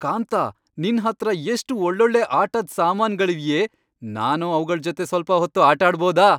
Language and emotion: Kannada, happy